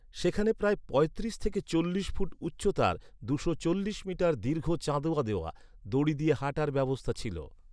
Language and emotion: Bengali, neutral